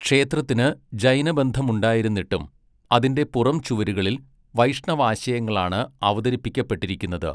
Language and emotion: Malayalam, neutral